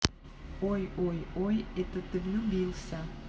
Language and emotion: Russian, neutral